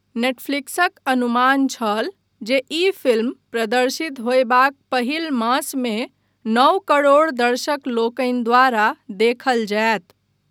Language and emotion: Maithili, neutral